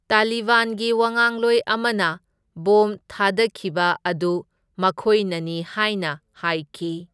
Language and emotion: Manipuri, neutral